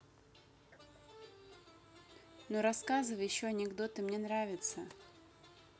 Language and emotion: Russian, neutral